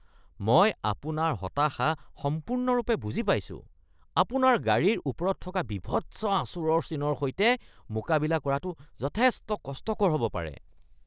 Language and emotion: Assamese, disgusted